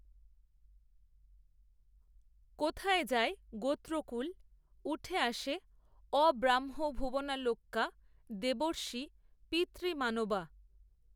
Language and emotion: Bengali, neutral